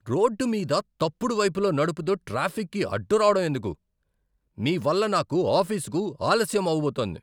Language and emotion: Telugu, angry